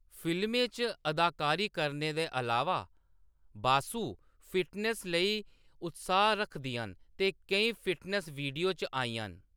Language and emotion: Dogri, neutral